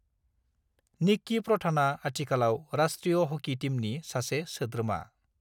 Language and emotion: Bodo, neutral